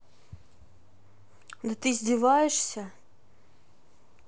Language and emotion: Russian, angry